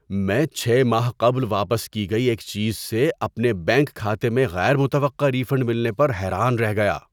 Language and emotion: Urdu, surprised